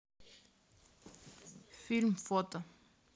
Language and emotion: Russian, neutral